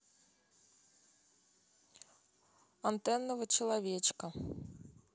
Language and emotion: Russian, neutral